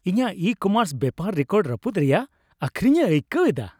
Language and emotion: Santali, happy